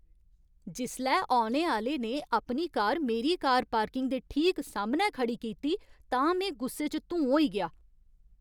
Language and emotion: Dogri, angry